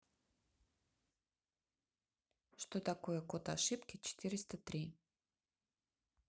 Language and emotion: Russian, neutral